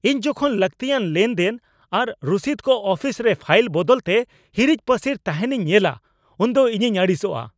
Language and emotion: Santali, angry